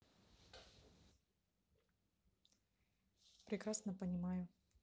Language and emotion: Russian, neutral